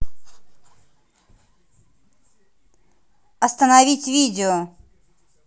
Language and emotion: Russian, angry